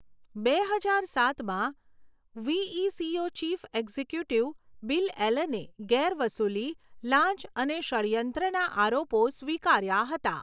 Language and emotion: Gujarati, neutral